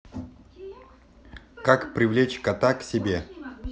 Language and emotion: Russian, neutral